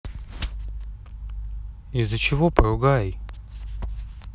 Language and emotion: Russian, neutral